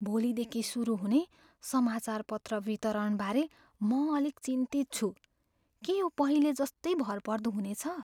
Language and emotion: Nepali, fearful